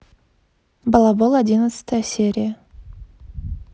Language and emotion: Russian, neutral